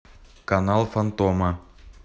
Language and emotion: Russian, neutral